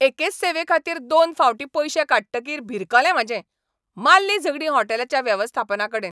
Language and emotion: Goan Konkani, angry